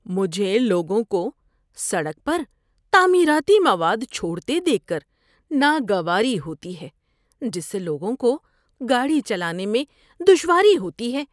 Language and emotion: Urdu, disgusted